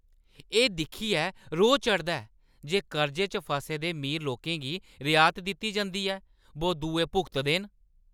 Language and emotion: Dogri, angry